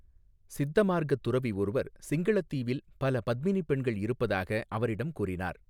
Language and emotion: Tamil, neutral